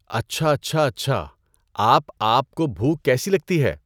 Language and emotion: Urdu, neutral